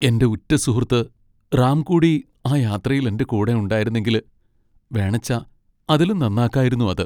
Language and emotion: Malayalam, sad